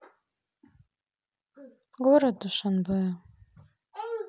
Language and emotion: Russian, sad